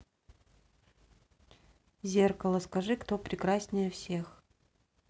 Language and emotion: Russian, neutral